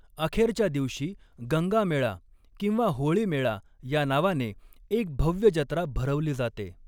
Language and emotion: Marathi, neutral